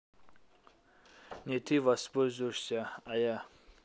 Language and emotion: Russian, neutral